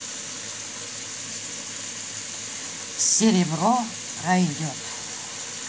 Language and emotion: Russian, positive